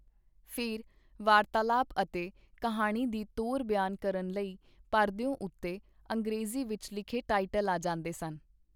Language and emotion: Punjabi, neutral